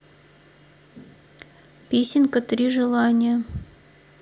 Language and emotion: Russian, neutral